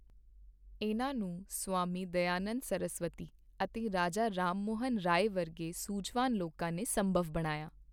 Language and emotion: Punjabi, neutral